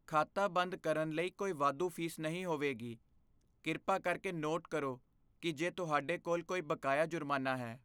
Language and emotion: Punjabi, fearful